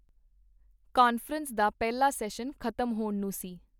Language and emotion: Punjabi, neutral